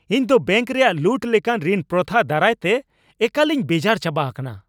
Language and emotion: Santali, angry